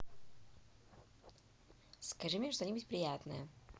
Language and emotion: Russian, positive